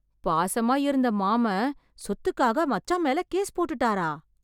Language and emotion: Tamil, surprised